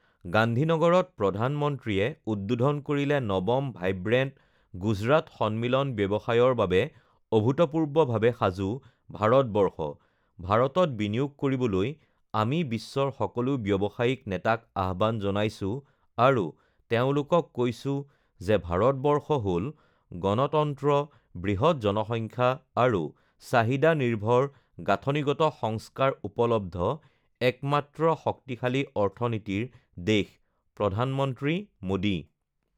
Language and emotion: Assamese, neutral